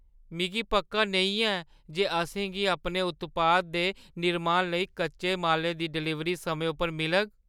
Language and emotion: Dogri, fearful